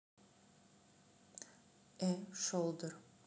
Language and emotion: Russian, neutral